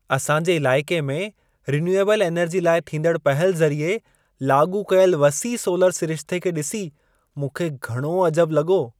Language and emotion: Sindhi, surprised